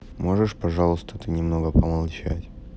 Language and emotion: Russian, sad